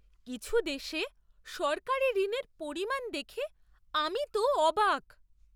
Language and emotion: Bengali, surprised